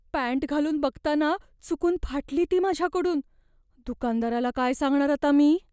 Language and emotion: Marathi, fearful